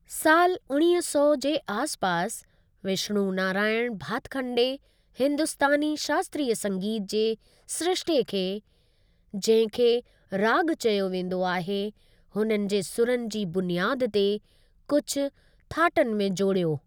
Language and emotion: Sindhi, neutral